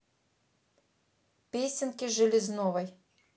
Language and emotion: Russian, neutral